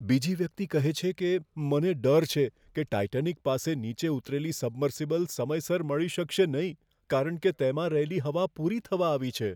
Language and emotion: Gujarati, fearful